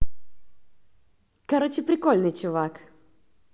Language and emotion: Russian, positive